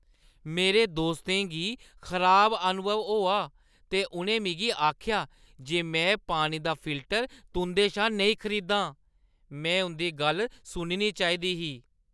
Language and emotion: Dogri, disgusted